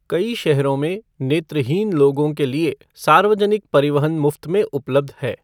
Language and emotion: Hindi, neutral